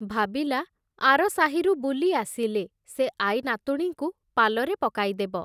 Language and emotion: Odia, neutral